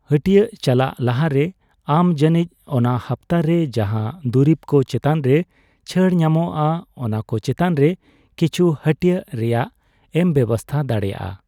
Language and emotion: Santali, neutral